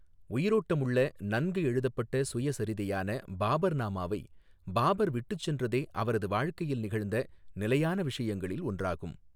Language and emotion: Tamil, neutral